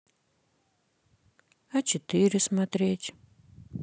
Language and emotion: Russian, sad